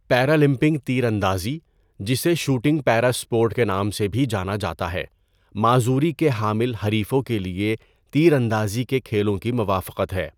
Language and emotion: Urdu, neutral